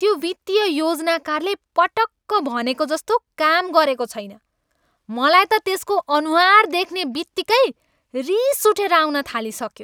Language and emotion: Nepali, angry